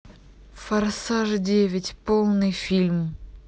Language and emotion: Russian, neutral